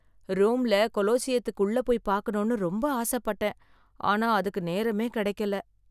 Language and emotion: Tamil, sad